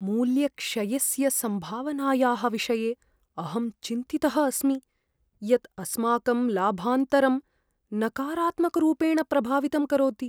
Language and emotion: Sanskrit, fearful